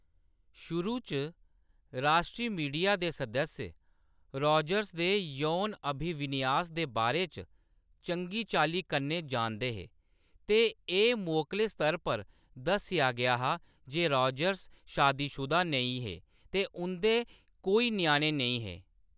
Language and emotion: Dogri, neutral